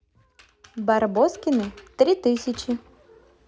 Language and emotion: Russian, positive